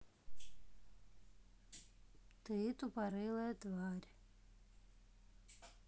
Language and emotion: Russian, neutral